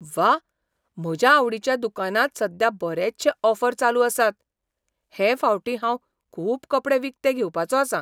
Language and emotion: Goan Konkani, surprised